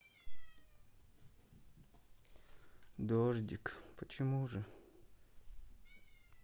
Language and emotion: Russian, sad